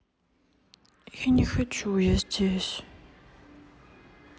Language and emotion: Russian, sad